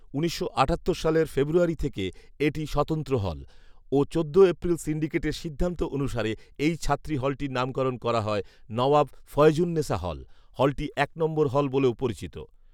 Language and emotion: Bengali, neutral